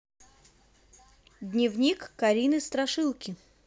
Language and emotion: Russian, positive